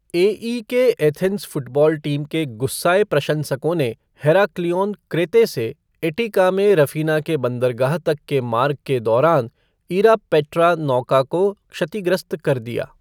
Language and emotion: Hindi, neutral